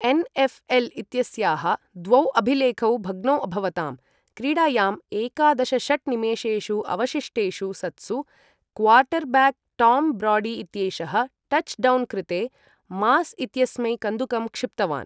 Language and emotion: Sanskrit, neutral